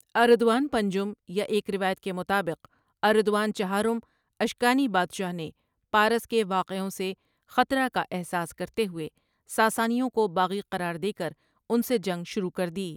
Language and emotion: Urdu, neutral